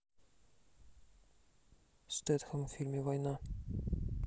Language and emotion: Russian, neutral